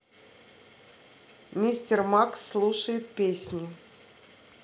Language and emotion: Russian, neutral